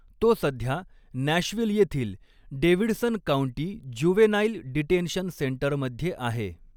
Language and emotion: Marathi, neutral